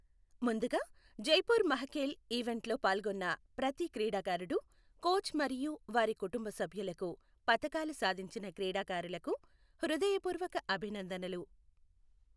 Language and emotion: Telugu, neutral